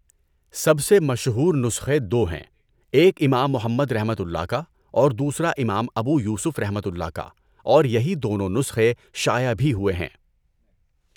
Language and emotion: Urdu, neutral